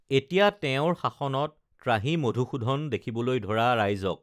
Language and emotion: Assamese, neutral